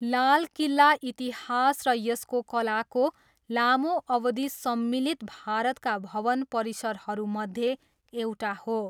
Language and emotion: Nepali, neutral